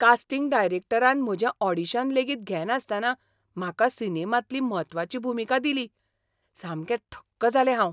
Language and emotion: Goan Konkani, surprised